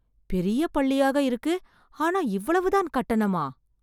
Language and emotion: Tamil, surprised